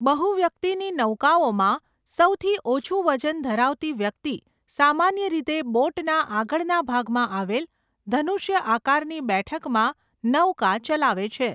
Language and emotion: Gujarati, neutral